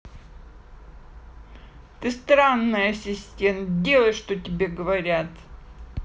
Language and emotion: Russian, angry